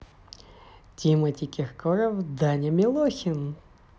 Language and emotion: Russian, positive